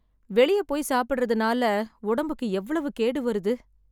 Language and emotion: Tamil, sad